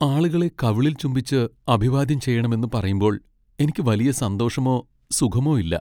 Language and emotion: Malayalam, sad